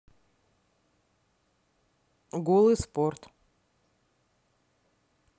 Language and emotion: Russian, neutral